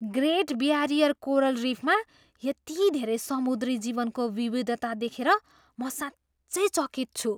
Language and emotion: Nepali, surprised